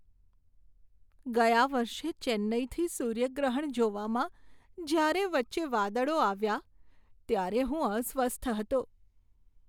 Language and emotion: Gujarati, sad